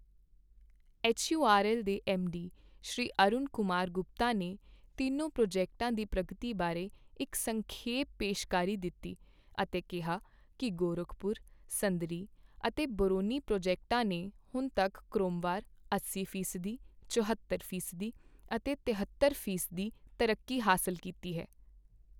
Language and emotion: Punjabi, neutral